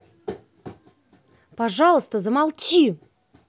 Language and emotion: Russian, angry